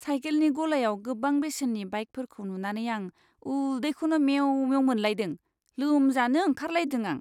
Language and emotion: Bodo, disgusted